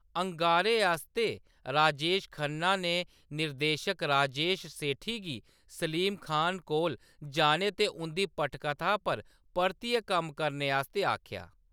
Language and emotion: Dogri, neutral